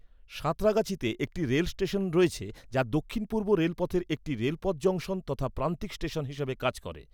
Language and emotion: Bengali, neutral